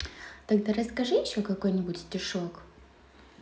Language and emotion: Russian, positive